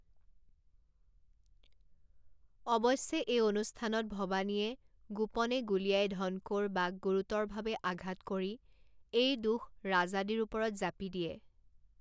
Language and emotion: Assamese, neutral